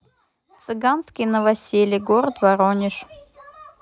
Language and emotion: Russian, neutral